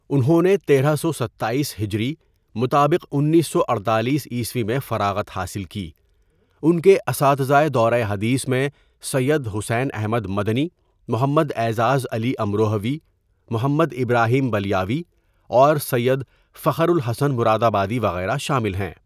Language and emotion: Urdu, neutral